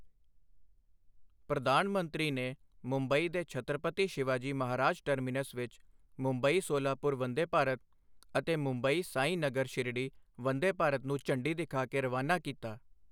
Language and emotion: Punjabi, neutral